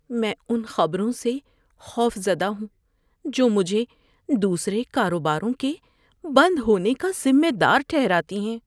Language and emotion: Urdu, fearful